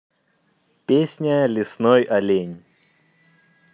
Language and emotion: Russian, neutral